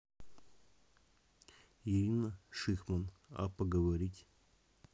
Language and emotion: Russian, neutral